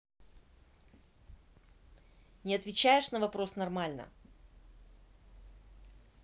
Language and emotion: Russian, angry